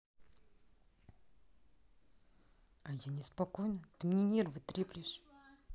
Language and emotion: Russian, angry